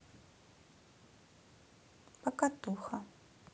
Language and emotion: Russian, neutral